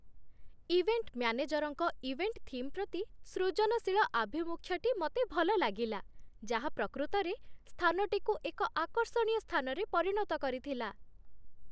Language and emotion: Odia, happy